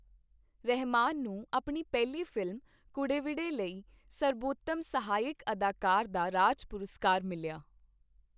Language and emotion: Punjabi, neutral